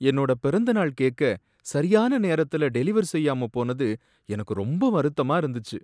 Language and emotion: Tamil, sad